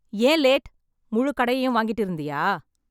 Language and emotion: Tamil, angry